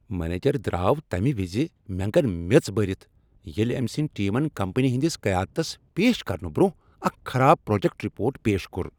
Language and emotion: Kashmiri, angry